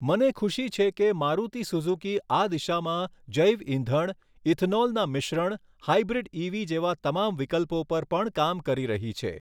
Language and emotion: Gujarati, neutral